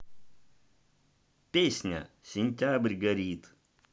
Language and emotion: Russian, positive